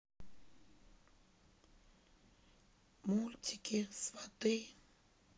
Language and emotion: Russian, sad